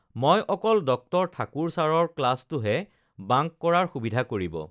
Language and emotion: Assamese, neutral